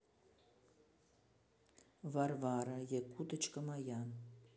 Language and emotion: Russian, neutral